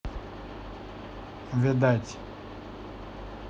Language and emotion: Russian, neutral